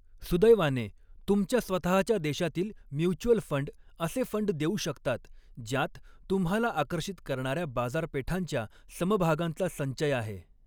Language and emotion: Marathi, neutral